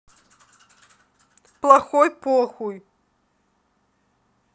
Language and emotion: Russian, neutral